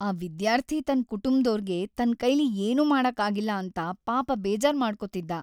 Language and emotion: Kannada, sad